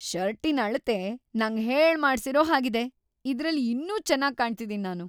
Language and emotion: Kannada, happy